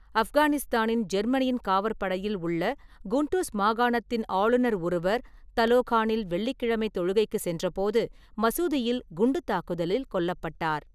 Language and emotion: Tamil, neutral